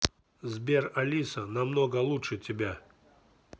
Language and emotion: Russian, neutral